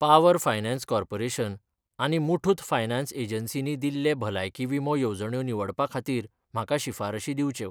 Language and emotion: Goan Konkani, neutral